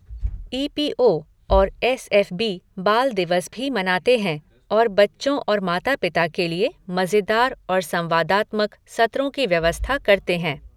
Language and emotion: Hindi, neutral